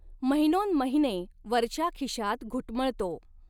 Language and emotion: Marathi, neutral